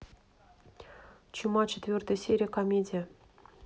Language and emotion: Russian, neutral